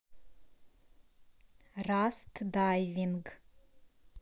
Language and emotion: Russian, neutral